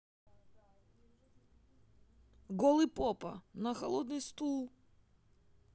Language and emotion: Russian, sad